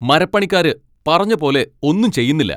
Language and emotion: Malayalam, angry